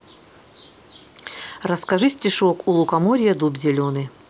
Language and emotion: Russian, neutral